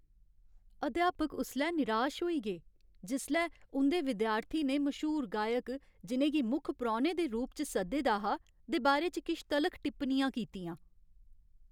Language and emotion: Dogri, sad